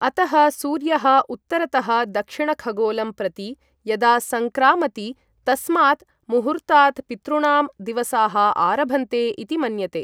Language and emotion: Sanskrit, neutral